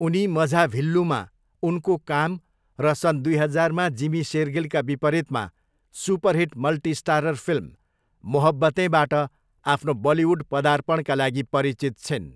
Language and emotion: Nepali, neutral